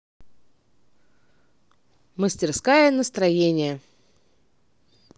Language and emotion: Russian, positive